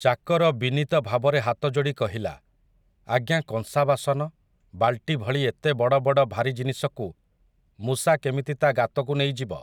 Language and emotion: Odia, neutral